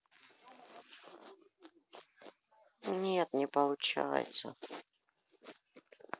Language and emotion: Russian, sad